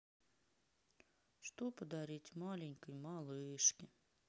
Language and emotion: Russian, sad